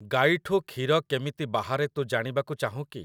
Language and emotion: Odia, neutral